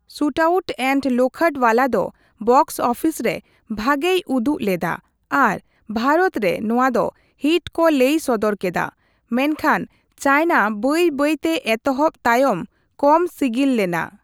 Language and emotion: Santali, neutral